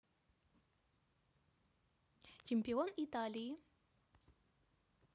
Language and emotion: Russian, neutral